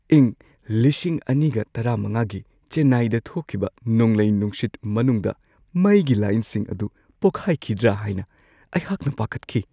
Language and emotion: Manipuri, fearful